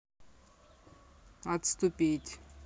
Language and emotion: Russian, neutral